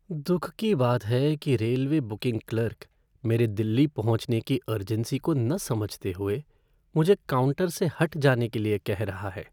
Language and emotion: Hindi, sad